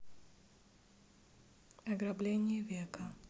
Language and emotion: Russian, neutral